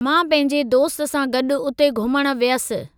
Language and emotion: Sindhi, neutral